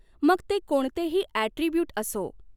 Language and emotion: Marathi, neutral